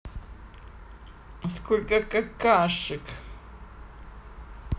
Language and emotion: Russian, neutral